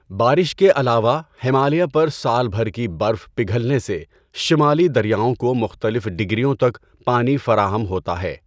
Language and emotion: Urdu, neutral